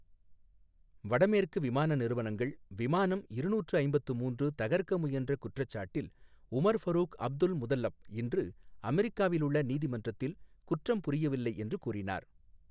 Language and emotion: Tamil, neutral